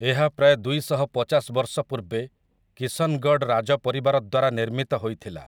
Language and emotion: Odia, neutral